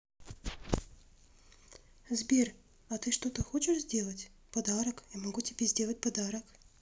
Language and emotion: Russian, neutral